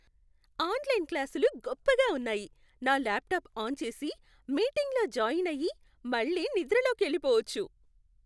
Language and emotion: Telugu, happy